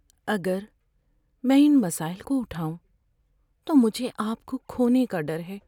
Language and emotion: Urdu, fearful